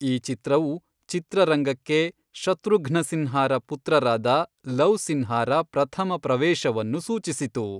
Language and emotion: Kannada, neutral